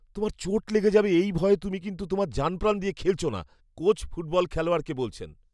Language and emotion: Bengali, fearful